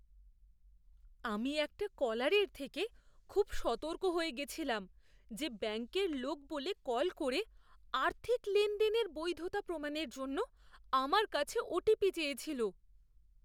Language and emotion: Bengali, fearful